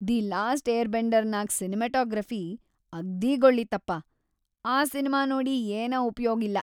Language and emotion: Kannada, disgusted